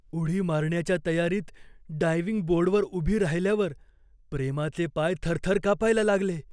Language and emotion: Marathi, fearful